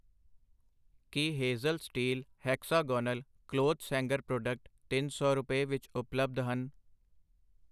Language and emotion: Punjabi, neutral